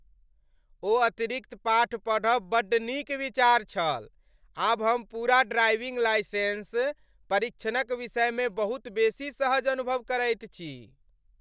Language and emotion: Maithili, happy